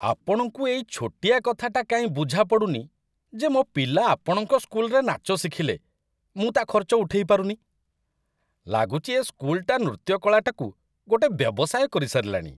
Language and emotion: Odia, disgusted